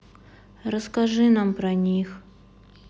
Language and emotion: Russian, sad